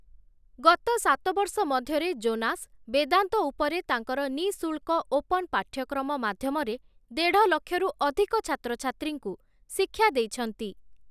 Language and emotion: Odia, neutral